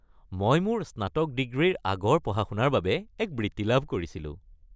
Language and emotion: Assamese, happy